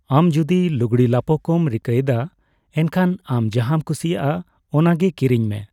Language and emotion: Santali, neutral